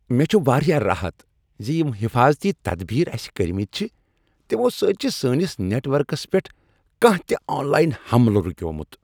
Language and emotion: Kashmiri, happy